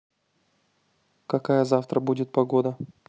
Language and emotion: Russian, neutral